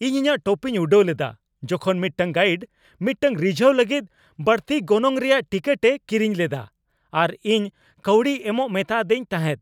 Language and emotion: Santali, angry